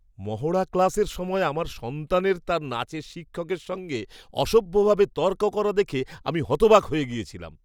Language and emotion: Bengali, surprised